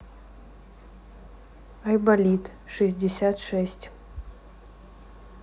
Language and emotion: Russian, neutral